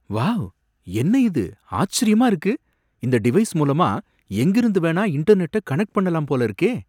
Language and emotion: Tamil, surprised